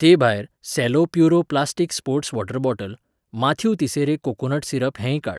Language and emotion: Goan Konkani, neutral